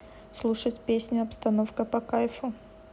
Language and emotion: Russian, neutral